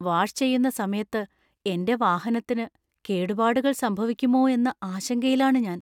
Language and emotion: Malayalam, fearful